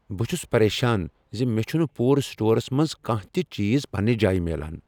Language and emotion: Kashmiri, angry